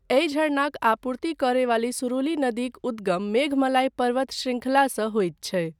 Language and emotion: Maithili, neutral